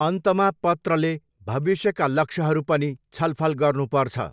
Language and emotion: Nepali, neutral